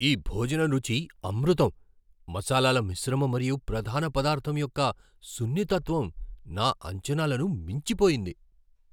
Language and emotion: Telugu, surprised